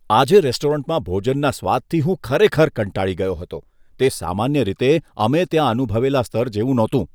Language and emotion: Gujarati, disgusted